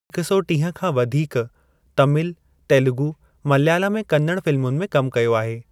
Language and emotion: Sindhi, neutral